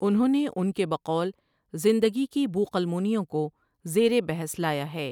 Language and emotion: Urdu, neutral